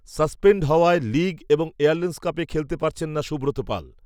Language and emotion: Bengali, neutral